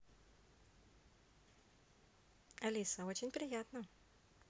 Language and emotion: Russian, positive